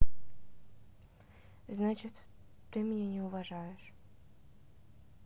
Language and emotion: Russian, sad